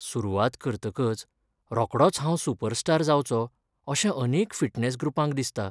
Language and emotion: Goan Konkani, sad